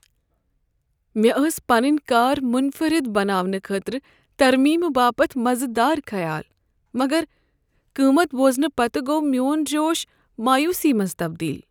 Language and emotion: Kashmiri, sad